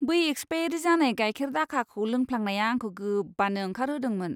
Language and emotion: Bodo, disgusted